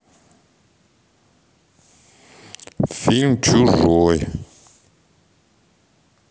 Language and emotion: Russian, neutral